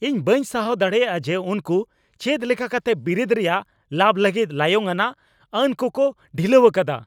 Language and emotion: Santali, angry